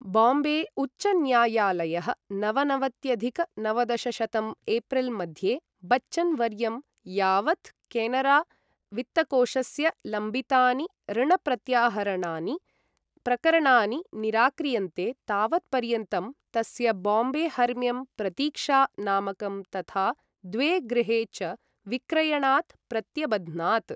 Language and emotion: Sanskrit, neutral